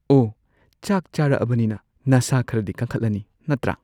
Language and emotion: Manipuri, neutral